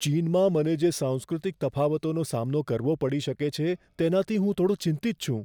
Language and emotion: Gujarati, fearful